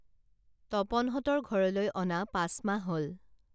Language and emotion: Assamese, neutral